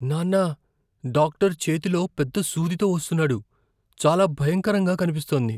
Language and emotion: Telugu, fearful